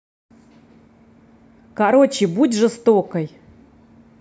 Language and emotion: Russian, neutral